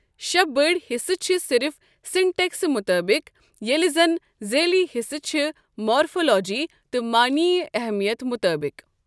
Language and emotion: Kashmiri, neutral